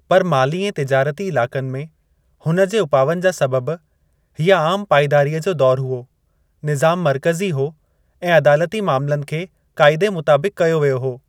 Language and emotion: Sindhi, neutral